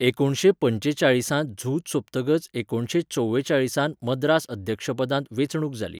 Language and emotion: Goan Konkani, neutral